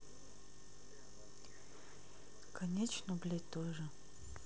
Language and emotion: Russian, sad